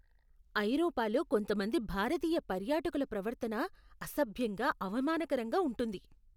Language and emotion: Telugu, disgusted